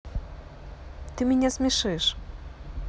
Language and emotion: Russian, positive